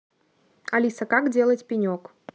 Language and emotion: Russian, neutral